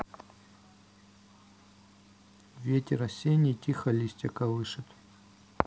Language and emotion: Russian, neutral